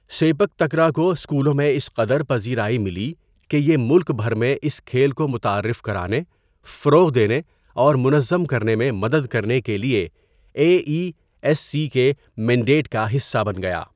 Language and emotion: Urdu, neutral